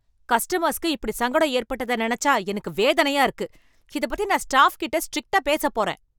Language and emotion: Tamil, angry